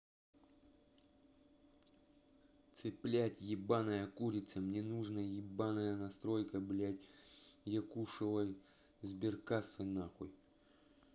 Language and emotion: Russian, angry